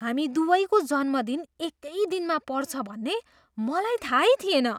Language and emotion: Nepali, surprised